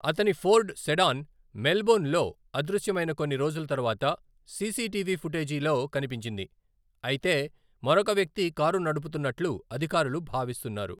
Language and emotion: Telugu, neutral